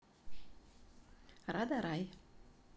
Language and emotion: Russian, neutral